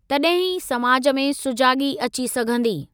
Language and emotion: Sindhi, neutral